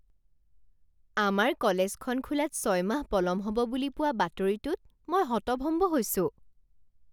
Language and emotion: Assamese, surprised